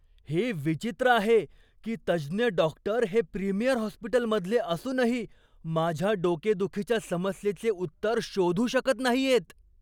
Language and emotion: Marathi, surprised